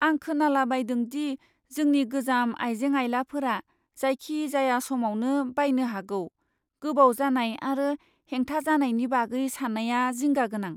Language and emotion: Bodo, fearful